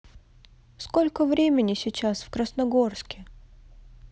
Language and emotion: Russian, neutral